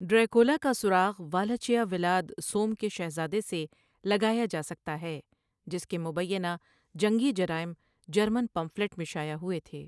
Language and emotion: Urdu, neutral